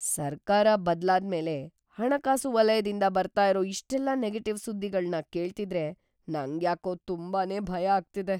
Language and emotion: Kannada, fearful